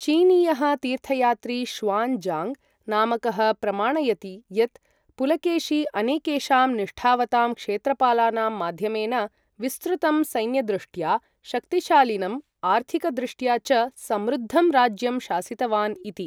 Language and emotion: Sanskrit, neutral